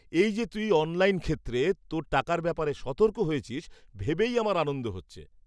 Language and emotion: Bengali, happy